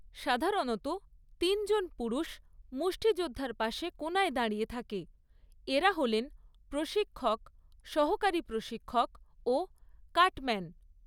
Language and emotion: Bengali, neutral